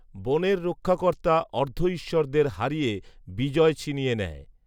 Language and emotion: Bengali, neutral